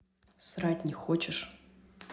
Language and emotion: Russian, neutral